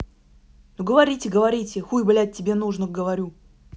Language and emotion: Russian, angry